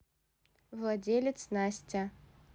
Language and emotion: Russian, neutral